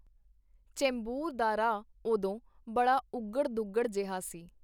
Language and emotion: Punjabi, neutral